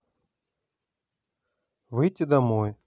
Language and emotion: Russian, neutral